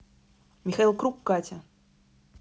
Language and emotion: Russian, neutral